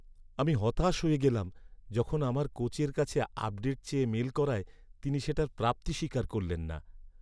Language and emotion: Bengali, sad